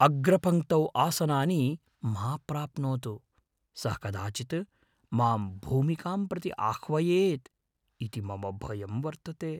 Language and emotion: Sanskrit, fearful